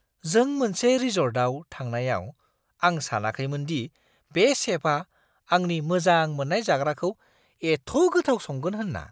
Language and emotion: Bodo, surprised